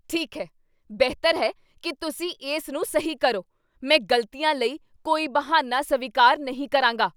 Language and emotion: Punjabi, angry